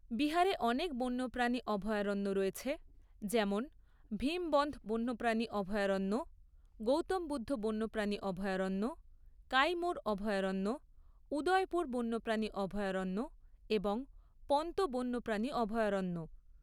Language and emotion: Bengali, neutral